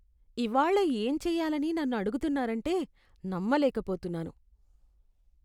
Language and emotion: Telugu, disgusted